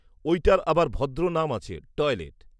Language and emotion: Bengali, neutral